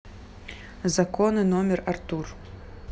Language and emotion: Russian, neutral